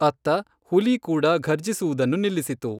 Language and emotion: Kannada, neutral